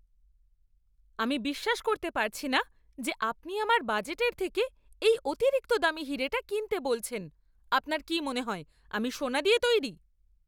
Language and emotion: Bengali, angry